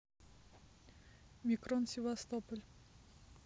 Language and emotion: Russian, neutral